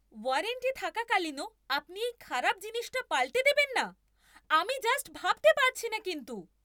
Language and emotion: Bengali, angry